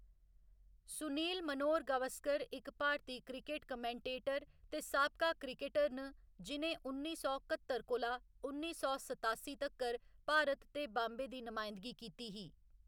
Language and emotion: Dogri, neutral